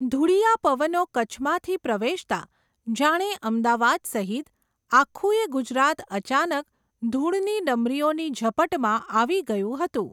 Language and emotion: Gujarati, neutral